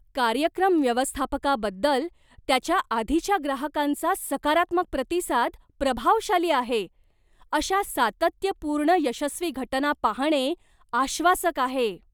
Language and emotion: Marathi, surprised